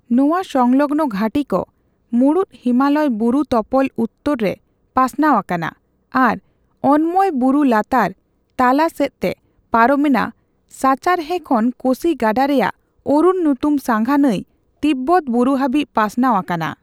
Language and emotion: Santali, neutral